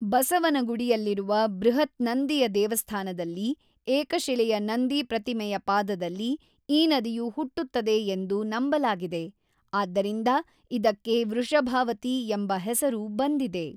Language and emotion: Kannada, neutral